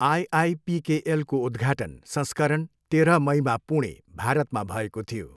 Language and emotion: Nepali, neutral